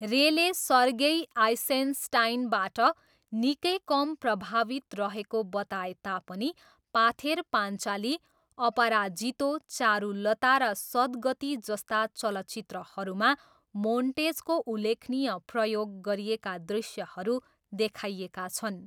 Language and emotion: Nepali, neutral